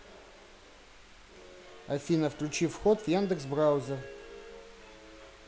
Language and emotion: Russian, neutral